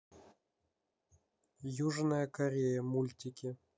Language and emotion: Russian, neutral